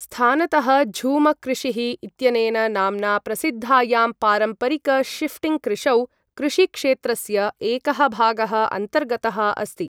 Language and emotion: Sanskrit, neutral